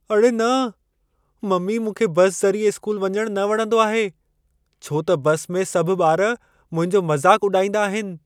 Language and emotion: Sindhi, fearful